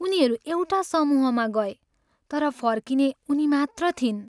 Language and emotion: Nepali, sad